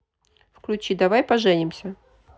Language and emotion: Russian, neutral